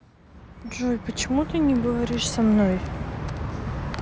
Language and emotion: Russian, sad